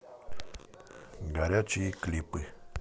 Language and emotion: Russian, neutral